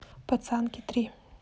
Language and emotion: Russian, neutral